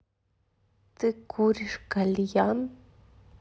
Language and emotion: Russian, neutral